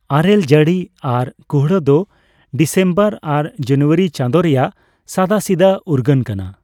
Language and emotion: Santali, neutral